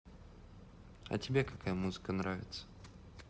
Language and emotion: Russian, neutral